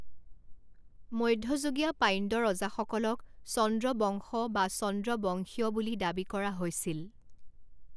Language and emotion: Assamese, neutral